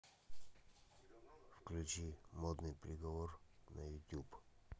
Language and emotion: Russian, neutral